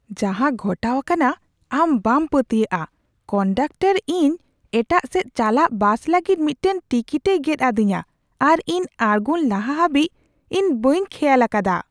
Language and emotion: Santali, surprised